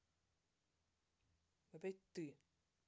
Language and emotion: Russian, angry